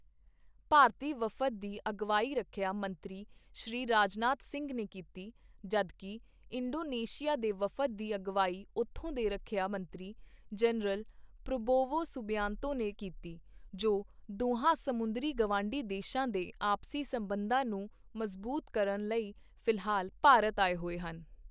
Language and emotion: Punjabi, neutral